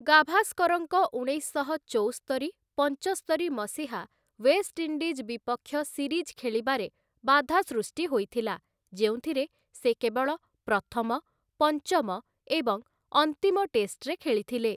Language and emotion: Odia, neutral